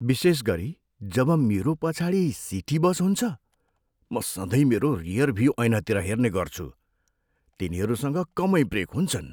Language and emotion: Nepali, fearful